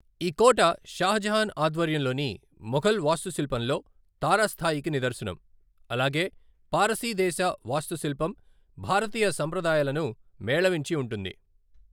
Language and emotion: Telugu, neutral